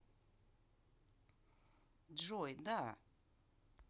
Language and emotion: Russian, neutral